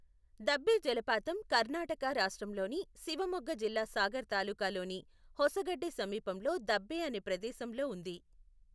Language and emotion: Telugu, neutral